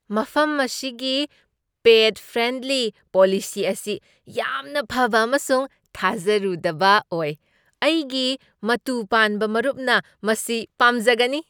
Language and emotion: Manipuri, surprised